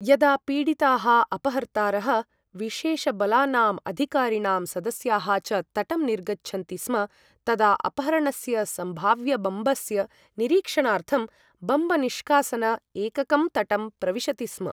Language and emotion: Sanskrit, neutral